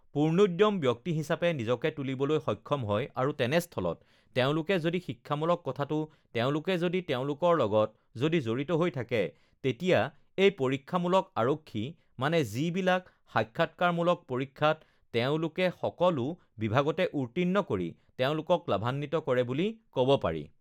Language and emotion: Assamese, neutral